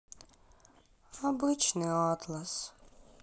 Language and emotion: Russian, sad